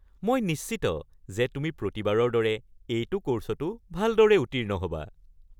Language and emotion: Assamese, happy